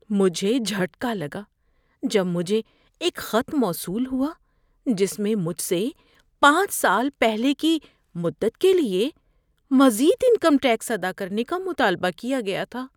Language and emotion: Urdu, fearful